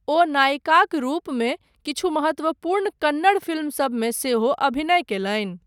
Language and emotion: Maithili, neutral